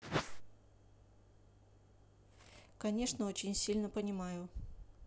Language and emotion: Russian, neutral